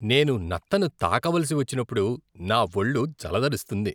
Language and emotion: Telugu, disgusted